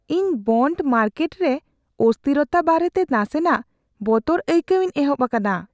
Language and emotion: Santali, fearful